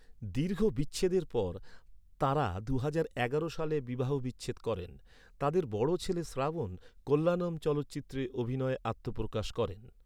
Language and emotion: Bengali, neutral